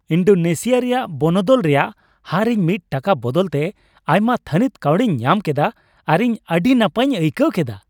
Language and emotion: Santali, happy